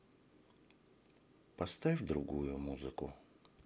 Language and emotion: Russian, sad